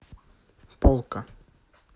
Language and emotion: Russian, neutral